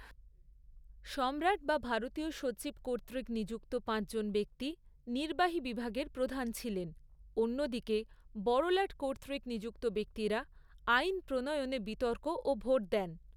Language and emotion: Bengali, neutral